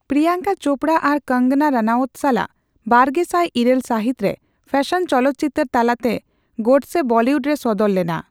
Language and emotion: Santali, neutral